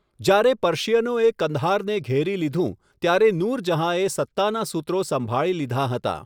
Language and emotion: Gujarati, neutral